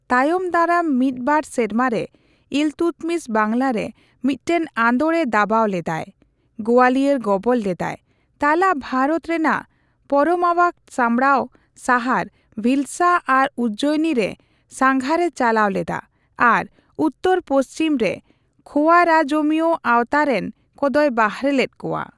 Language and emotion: Santali, neutral